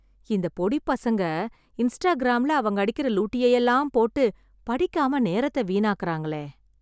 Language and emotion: Tamil, sad